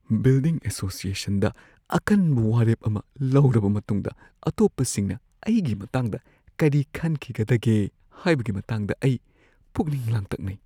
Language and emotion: Manipuri, fearful